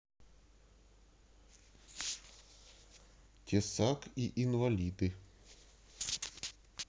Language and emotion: Russian, neutral